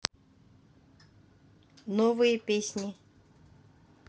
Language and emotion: Russian, neutral